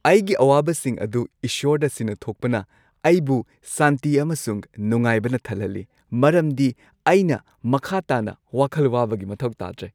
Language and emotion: Manipuri, happy